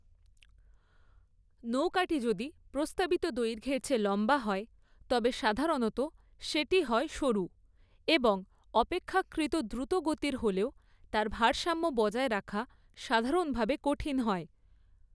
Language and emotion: Bengali, neutral